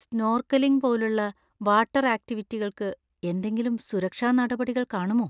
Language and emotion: Malayalam, fearful